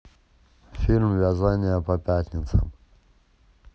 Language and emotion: Russian, neutral